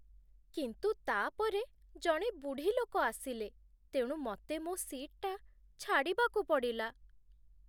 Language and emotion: Odia, sad